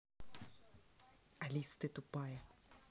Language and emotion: Russian, angry